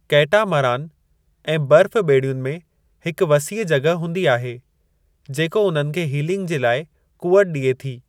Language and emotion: Sindhi, neutral